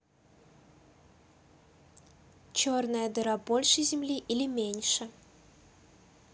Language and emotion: Russian, neutral